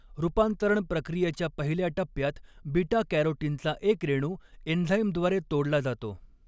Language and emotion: Marathi, neutral